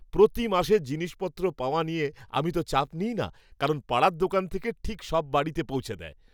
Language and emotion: Bengali, happy